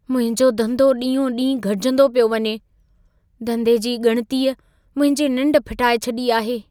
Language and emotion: Sindhi, fearful